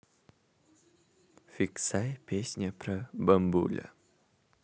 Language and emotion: Russian, neutral